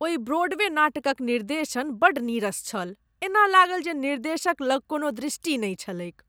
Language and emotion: Maithili, disgusted